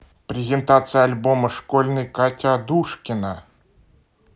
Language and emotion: Russian, neutral